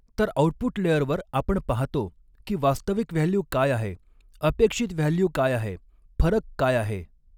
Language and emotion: Marathi, neutral